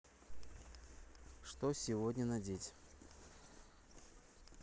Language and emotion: Russian, neutral